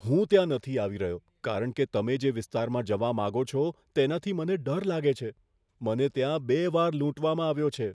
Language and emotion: Gujarati, fearful